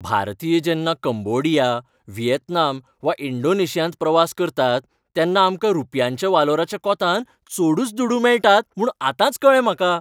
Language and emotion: Goan Konkani, happy